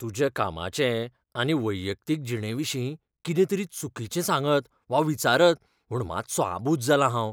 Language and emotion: Goan Konkani, fearful